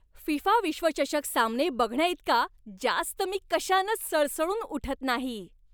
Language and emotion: Marathi, happy